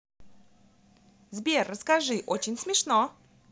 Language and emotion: Russian, positive